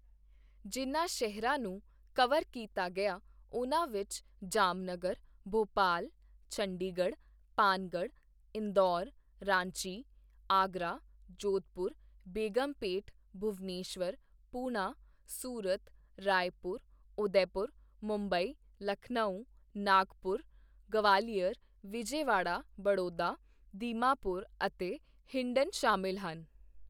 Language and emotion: Punjabi, neutral